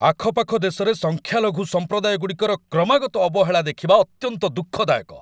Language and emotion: Odia, angry